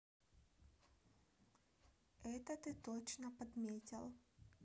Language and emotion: Russian, neutral